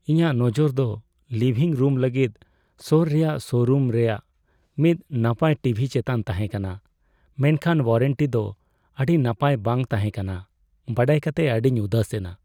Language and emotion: Santali, sad